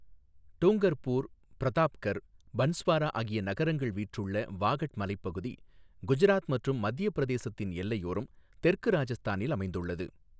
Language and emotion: Tamil, neutral